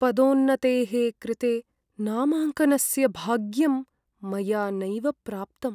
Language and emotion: Sanskrit, sad